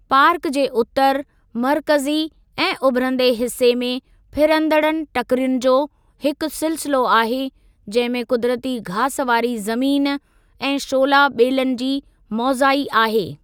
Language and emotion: Sindhi, neutral